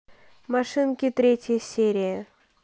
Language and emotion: Russian, neutral